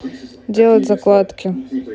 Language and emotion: Russian, neutral